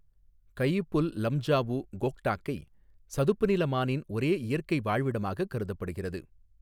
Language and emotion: Tamil, neutral